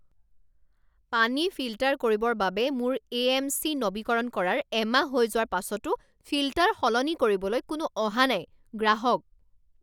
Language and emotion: Assamese, angry